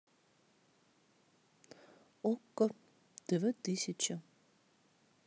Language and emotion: Russian, neutral